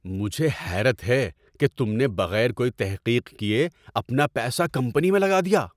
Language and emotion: Urdu, surprised